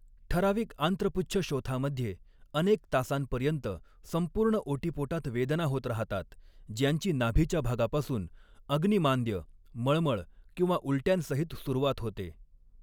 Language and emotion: Marathi, neutral